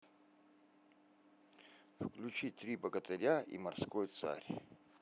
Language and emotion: Russian, neutral